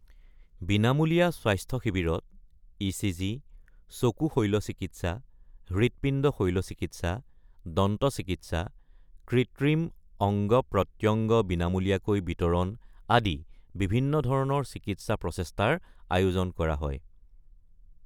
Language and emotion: Assamese, neutral